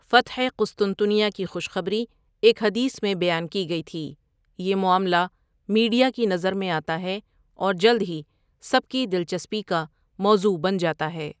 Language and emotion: Urdu, neutral